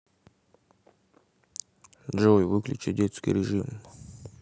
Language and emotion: Russian, neutral